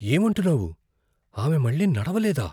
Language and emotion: Telugu, fearful